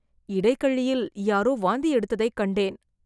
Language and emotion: Tamil, disgusted